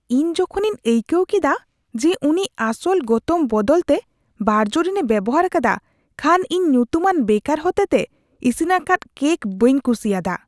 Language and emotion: Santali, disgusted